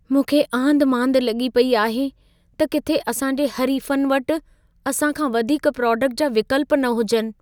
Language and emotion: Sindhi, fearful